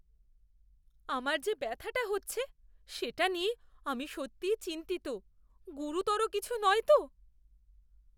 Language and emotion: Bengali, fearful